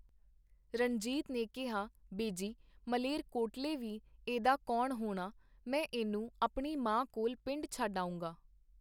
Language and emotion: Punjabi, neutral